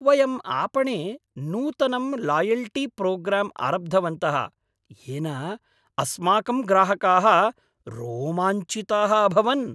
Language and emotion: Sanskrit, happy